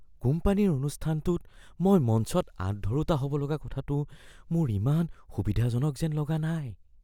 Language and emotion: Assamese, fearful